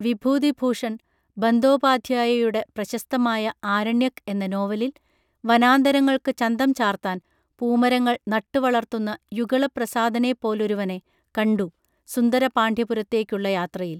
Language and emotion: Malayalam, neutral